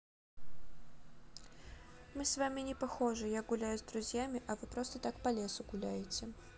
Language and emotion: Russian, neutral